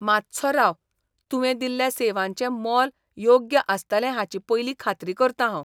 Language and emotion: Goan Konkani, disgusted